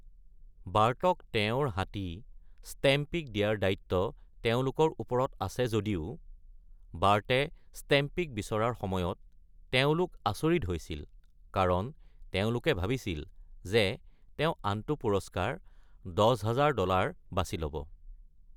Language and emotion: Assamese, neutral